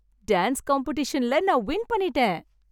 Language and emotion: Tamil, happy